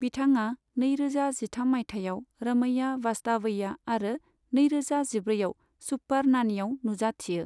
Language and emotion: Bodo, neutral